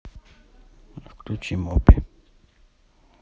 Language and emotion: Russian, neutral